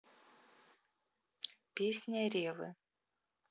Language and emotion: Russian, neutral